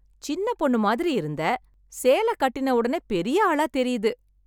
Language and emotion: Tamil, happy